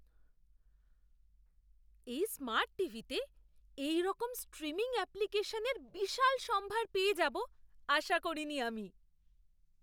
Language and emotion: Bengali, surprised